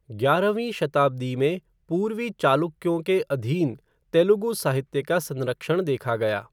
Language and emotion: Hindi, neutral